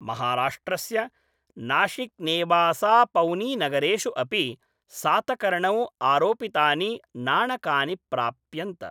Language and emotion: Sanskrit, neutral